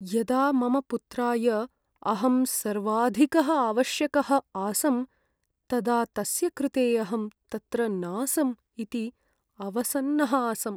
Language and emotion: Sanskrit, sad